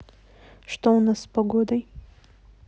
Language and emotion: Russian, neutral